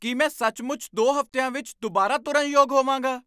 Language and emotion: Punjabi, surprised